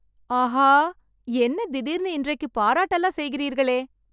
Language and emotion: Tamil, happy